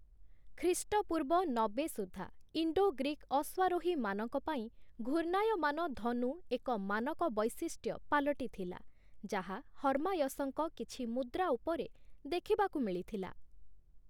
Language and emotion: Odia, neutral